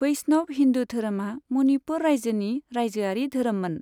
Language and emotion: Bodo, neutral